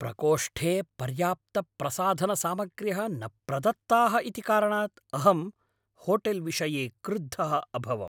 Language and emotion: Sanskrit, angry